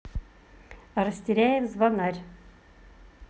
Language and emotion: Russian, positive